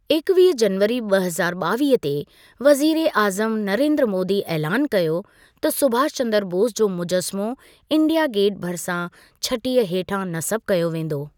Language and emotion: Sindhi, neutral